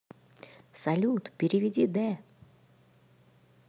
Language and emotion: Russian, positive